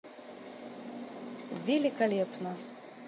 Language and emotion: Russian, neutral